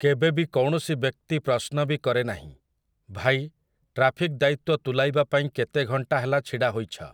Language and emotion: Odia, neutral